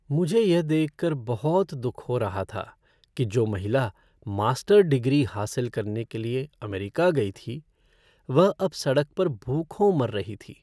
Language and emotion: Hindi, sad